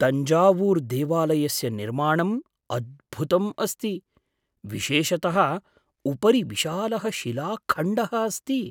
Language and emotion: Sanskrit, surprised